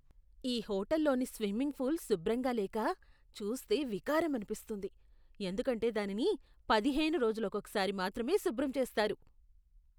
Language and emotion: Telugu, disgusted